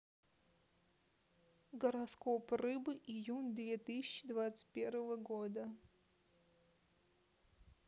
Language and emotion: Russian, neutral